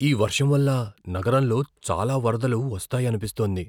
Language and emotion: Telugu, fearful